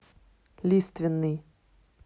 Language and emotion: Russian, neutral